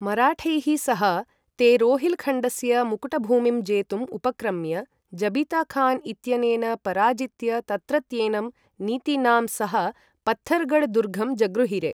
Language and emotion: Sanskrit, neutral